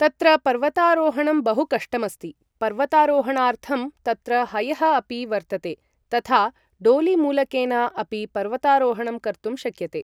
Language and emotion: Sanskrit, neutral